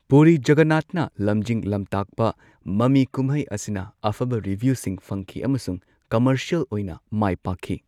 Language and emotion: Manipuri, neutral